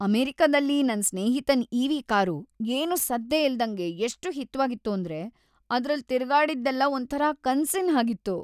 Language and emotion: Kannada, happy